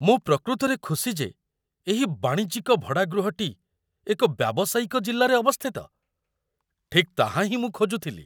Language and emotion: Odia, surprised